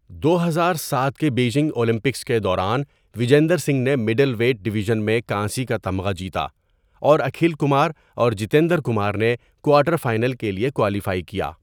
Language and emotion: Urdu, neutral